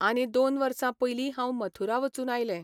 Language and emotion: Goan Konkani, neutral